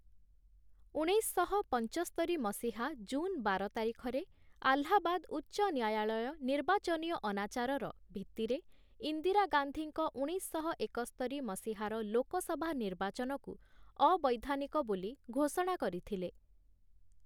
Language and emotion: Odia, neutral